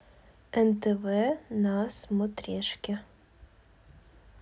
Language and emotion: Russian, neutral